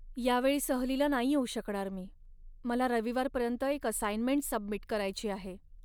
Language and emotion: Marathi, sad